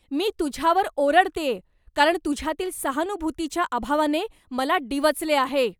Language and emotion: Marathi, angry